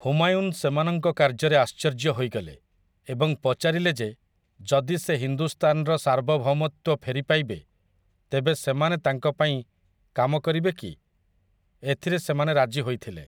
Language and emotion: Odia, neutral